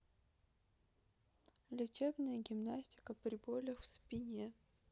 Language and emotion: Russian, neutral